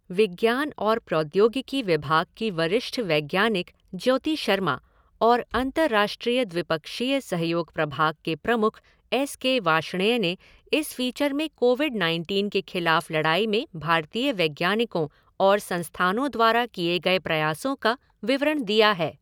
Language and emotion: Hindi, neutral